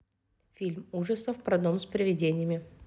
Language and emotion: Russian, neutral